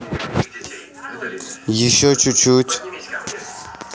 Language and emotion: Russian, neutral